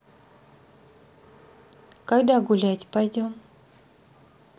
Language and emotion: Russian, neutral